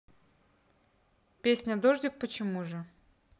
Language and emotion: Russian, neutral